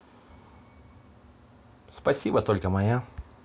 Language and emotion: Russian, neutral